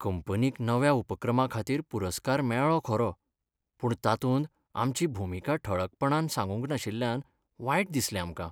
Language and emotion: Goan Konkani, sad